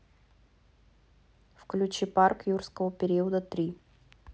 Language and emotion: Russian, neutral